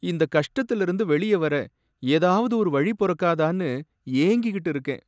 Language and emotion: Tamil, sad